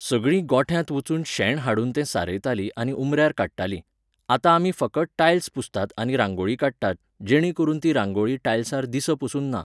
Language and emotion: Goan Konkani, neutral